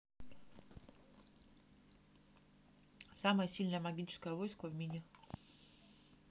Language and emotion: Russian, neutral